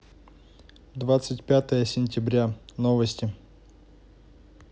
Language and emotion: Russian, neutral